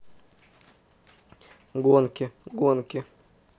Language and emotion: Russian, neutral